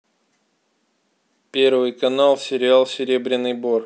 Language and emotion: Russian, neutral